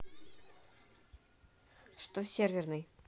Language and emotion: Russian, neutral